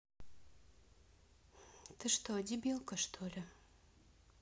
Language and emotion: Russian, neutral